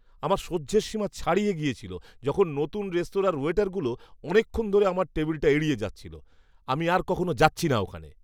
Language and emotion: Bengali, disgusted